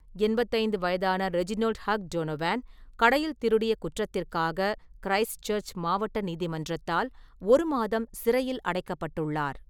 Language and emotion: Tamil, neutral